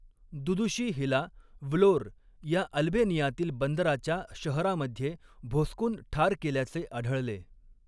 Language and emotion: Marathi, neutral